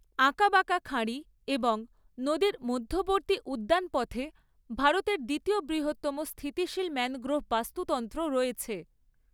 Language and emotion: Bengali, neutral